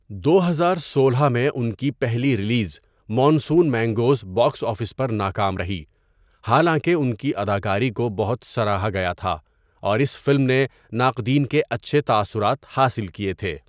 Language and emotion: Urdu, neutral